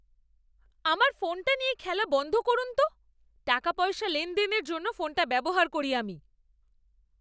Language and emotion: Bengali, angry